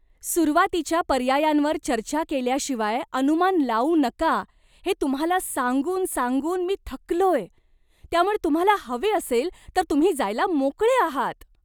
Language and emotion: Marathi, disgusted